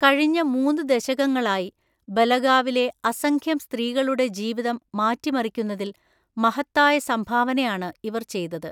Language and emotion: Malayalam, neutral